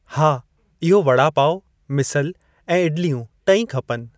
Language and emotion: Sindhi, neutral